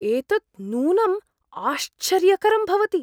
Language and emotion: Sanskrit, surprised